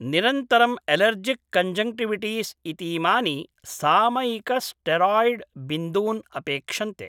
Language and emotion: Sanskrit, neutral